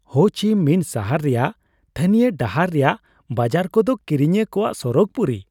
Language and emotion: Santali, happy